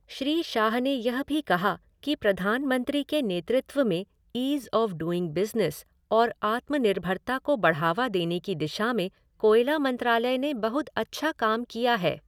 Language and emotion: Hindi, neutral